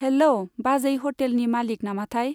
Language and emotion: Bodo, neutral